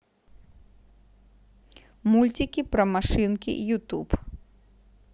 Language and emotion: Russian, neutral